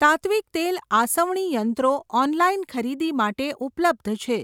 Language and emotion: Gujarati, neutral